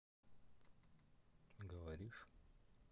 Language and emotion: Russian, neutral